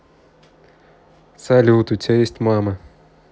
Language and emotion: Russian, neutral